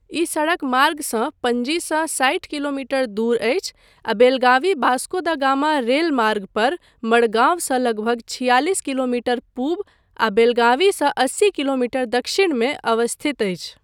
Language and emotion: Maithili, neutral